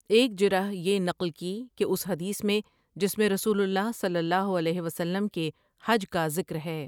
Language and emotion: Urdu, neutral